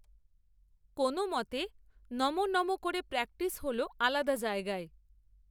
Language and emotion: Bengali, neutral